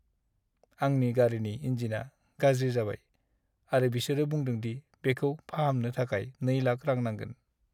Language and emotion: Bodo, sad